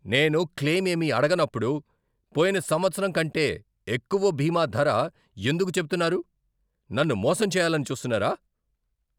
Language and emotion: Telugu, angry